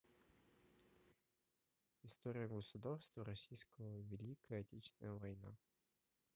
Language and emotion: Russian, neutral